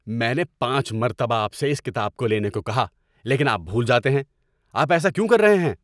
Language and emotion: Urdu, angry